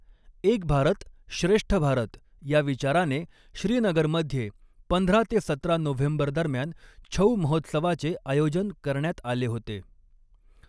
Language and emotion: Marathi, neutral